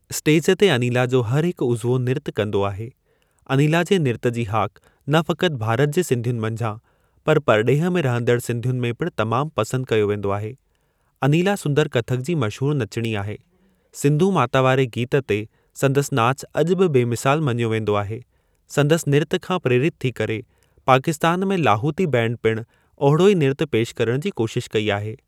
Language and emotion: Sindhi, neutral